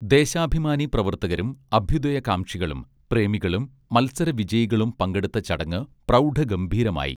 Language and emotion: Malayalam, neutral